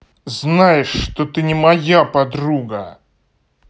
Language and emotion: Russian, angry